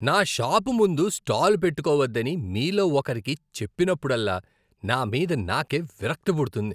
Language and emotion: Telugu, disgusted